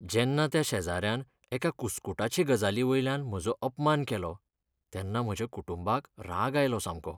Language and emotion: Goan Konkani, sad